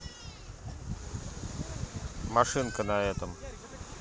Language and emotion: Russian, neutral